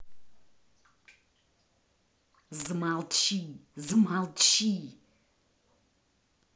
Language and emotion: Russian, angry